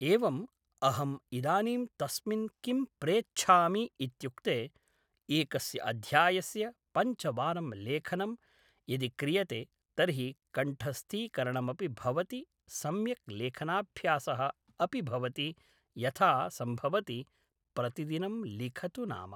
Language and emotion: Sanskrit, neutral